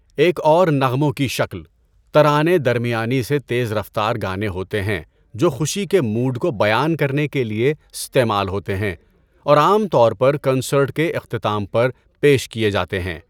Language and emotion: Urdu, neutral